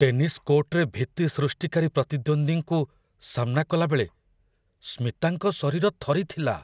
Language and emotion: Odia, fearful